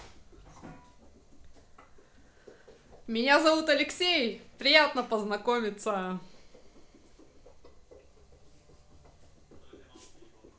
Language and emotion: Russian, positive